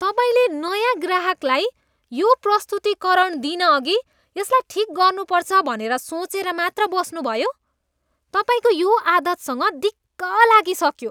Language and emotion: Nepali, disgusted